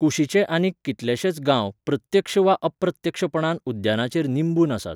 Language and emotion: Goan Konkani, neutral